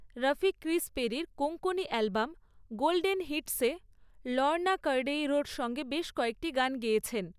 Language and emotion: Bengali, neutral